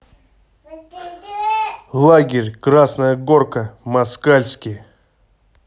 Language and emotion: Russian, neutral